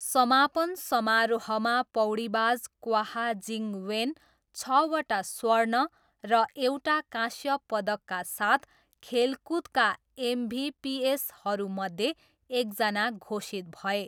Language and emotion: Nepali, neutral